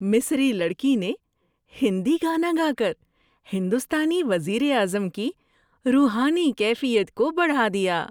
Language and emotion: Urdu, happy